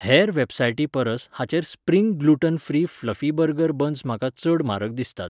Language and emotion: Goan Konkani, neutral